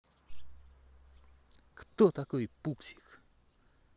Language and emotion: Russian, neutral